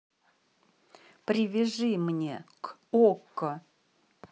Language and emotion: Russian, neutral